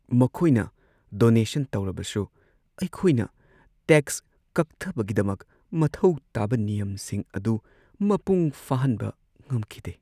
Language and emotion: Manipuri, sad